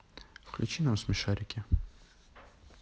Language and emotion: Russian, neutral